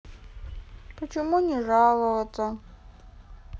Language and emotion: Russian, sad